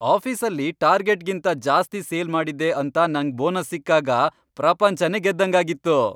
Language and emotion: Kannada, happy